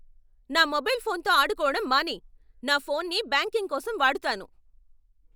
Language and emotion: Telugu, angry